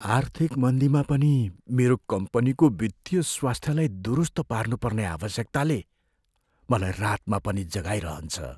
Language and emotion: Nepali, fearful